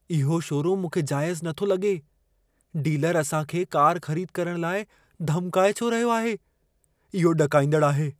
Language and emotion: Sindhi, fearful